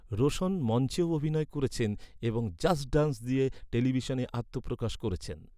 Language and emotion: Bengali, neutral